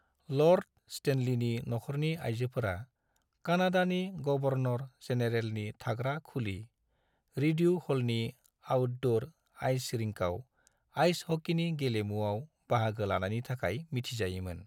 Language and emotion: Bodo, neutral